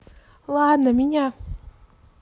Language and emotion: Russian, neutral